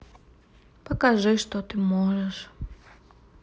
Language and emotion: Russian, sad